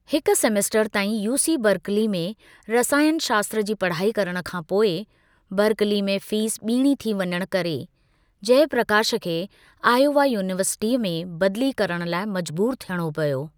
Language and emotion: Sindhi, neutral